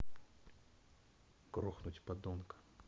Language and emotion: Russian, neutral